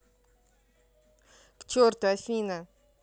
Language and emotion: Russian, angry